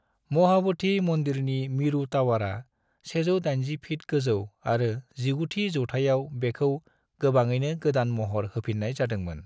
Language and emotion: Bodo, neutral